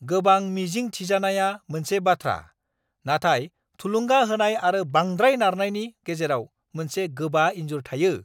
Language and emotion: Bodo, angry